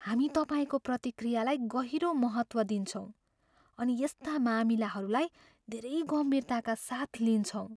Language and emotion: Nepali, fearful